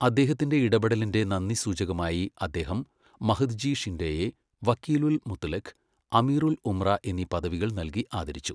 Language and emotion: Malayalam, neutral